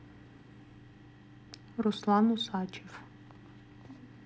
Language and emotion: Russian, neutral